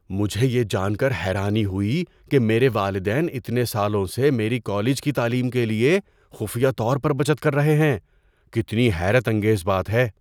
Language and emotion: Urdu, surprised